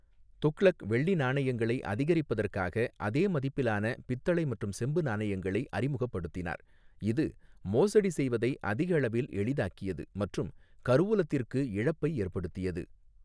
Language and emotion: Tamil, neutral